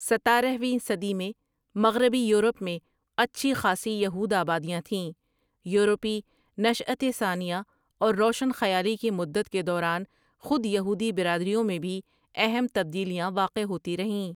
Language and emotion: Urdu, neutral